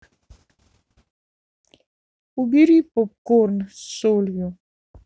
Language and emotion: Russian, sad